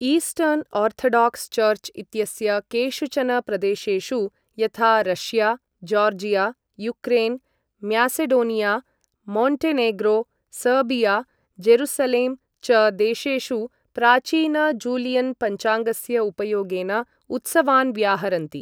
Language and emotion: Sanskrit, neutral